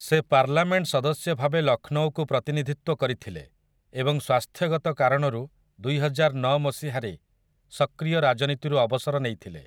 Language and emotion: Odia, neutral